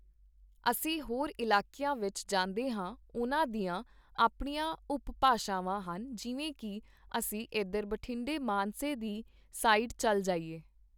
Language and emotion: Punjabi, neutral